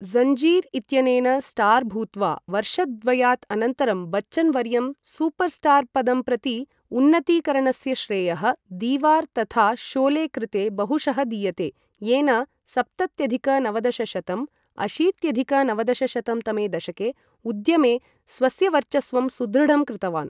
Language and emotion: Sanskrit, neutral